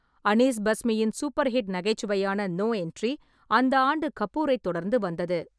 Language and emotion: Tamil, neutral